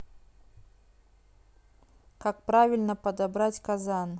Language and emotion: Russian, neutral